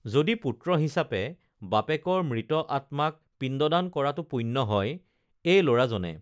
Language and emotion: Assamese, neutral